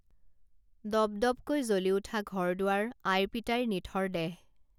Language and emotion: Assamese, neutral